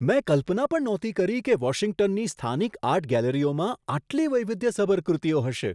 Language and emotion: Gujarati, surprised